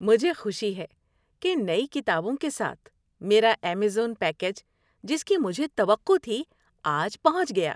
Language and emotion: Urdu, happy